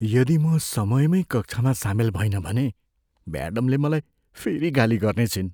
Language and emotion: Nepali, fearful